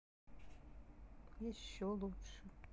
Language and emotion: Russian, sad